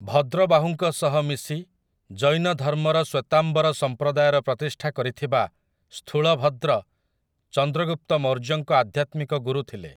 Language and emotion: Odia, neutral